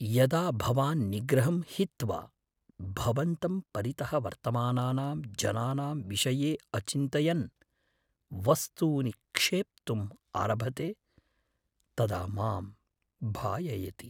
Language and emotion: Sanskrit, fearful